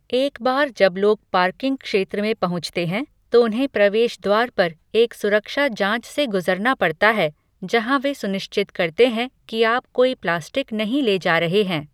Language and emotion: Hindi, neutral